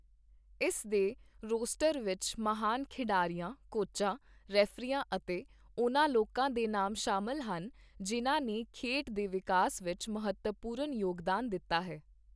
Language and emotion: Punjabi, neutral